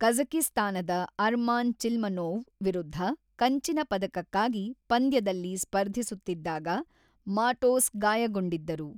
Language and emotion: Kannada, neutral